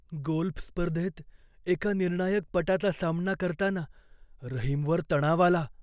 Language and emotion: Marathi, fearful